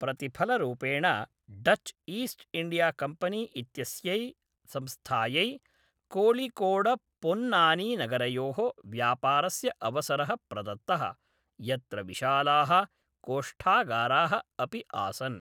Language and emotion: Sanskrit, neutral